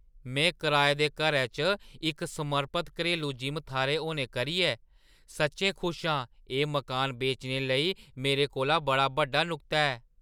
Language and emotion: Dogri, surprised